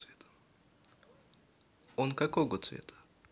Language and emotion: Russian, neutral